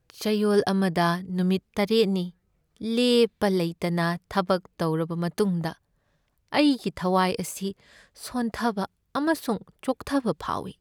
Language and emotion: Manipuri, sad